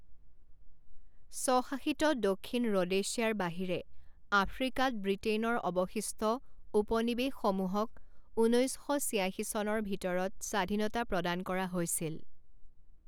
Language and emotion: Assamese, neutral